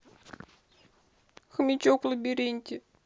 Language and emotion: Russian, sad